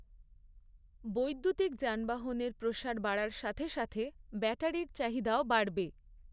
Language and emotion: Bengali, neutral